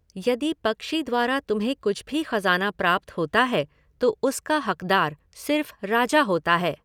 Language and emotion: Hindi, neutral